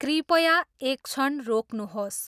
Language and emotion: Nepali, neutral